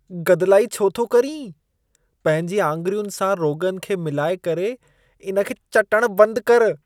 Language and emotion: Sindhi, disgusted